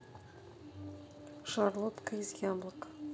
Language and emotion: Russian, neutral